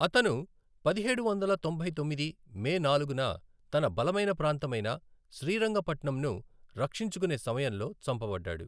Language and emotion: Telugu, neutral